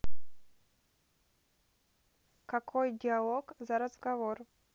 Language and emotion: Russian, neutral